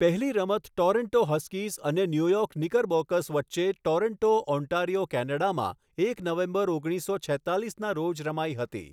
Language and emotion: Gujarati, neutral